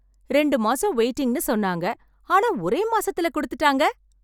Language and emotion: Tamil, happy